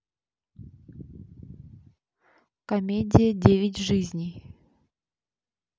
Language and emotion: Russian, neutral